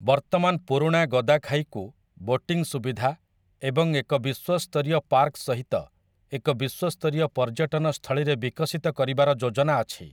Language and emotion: Odia, neutral